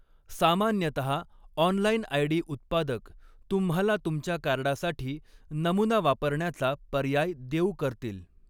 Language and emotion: Marathi, neutral